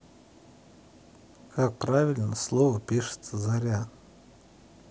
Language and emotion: Russian, neutral